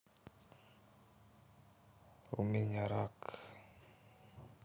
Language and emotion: Russian, sad